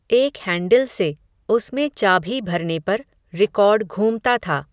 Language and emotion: Hindi, neutral